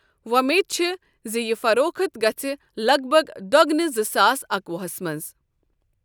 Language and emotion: Kashmiri, neutral